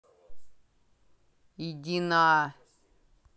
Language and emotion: Russian, angry